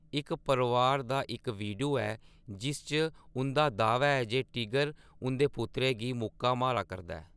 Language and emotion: Dogri, neutral